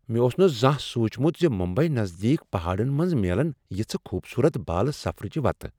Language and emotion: Kashmiri, surprised